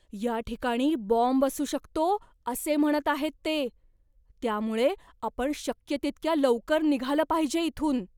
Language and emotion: Marathi, fearful